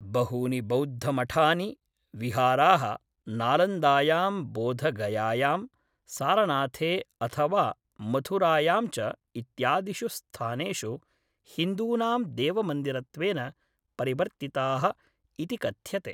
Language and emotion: Sanskrit, neutral